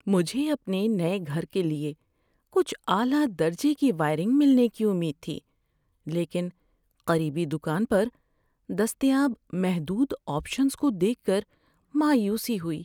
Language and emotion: Urdu, sad